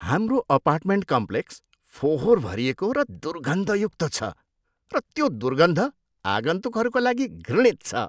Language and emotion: Nepali, disgusted